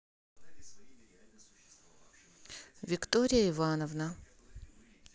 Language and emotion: Russian, neutral